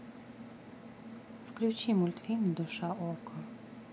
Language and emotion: Russian, neutral